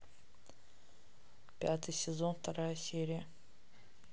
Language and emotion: Russian, neutral